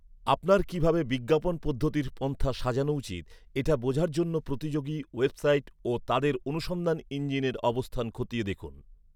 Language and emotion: Bengali, neutral